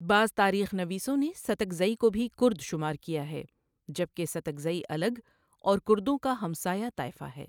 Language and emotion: Urdu, neutral